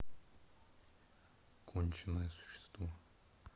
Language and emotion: Russian, angry